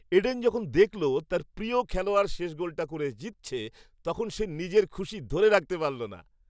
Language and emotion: Bengali, happy